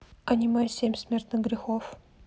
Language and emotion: Russian, neutral